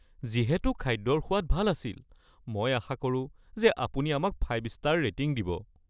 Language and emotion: Assamese, fearful